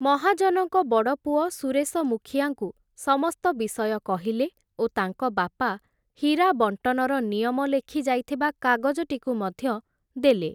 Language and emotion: Odia, neutral